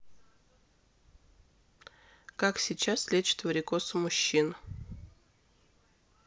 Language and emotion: Russian, neutral